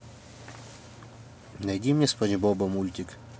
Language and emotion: Russian, neutral